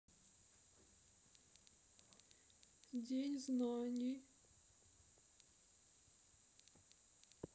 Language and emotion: Russian, sad